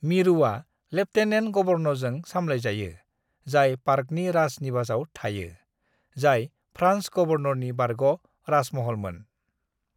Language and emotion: Bodo, neutral